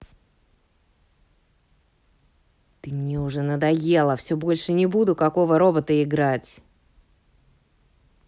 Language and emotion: Russian, angry